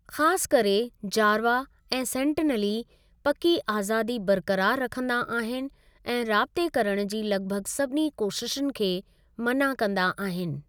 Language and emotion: Sindhi, neutral